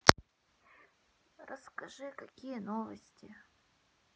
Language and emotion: Russian, sad